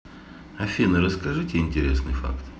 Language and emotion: Russian, neutral